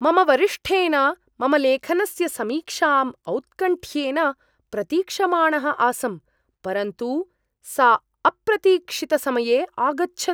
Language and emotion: Sanskrit, surprised